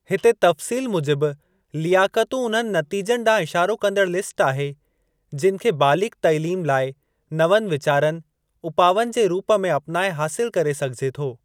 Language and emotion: Sindhi, neutral